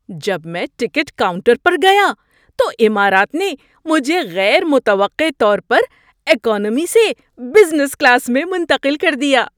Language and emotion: Urdu, surprised